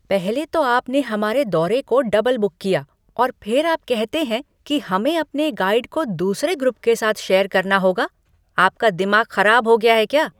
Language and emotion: Hindi, angry